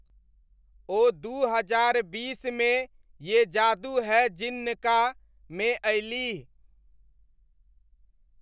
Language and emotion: Maithili, neutral